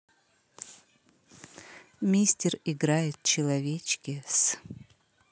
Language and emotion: Russian, neutral